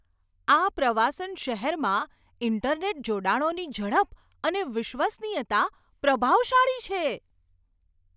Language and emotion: Gujarati, surprised